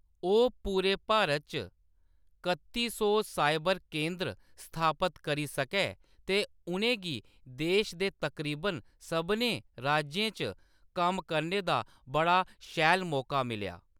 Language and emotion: Dogri, neutral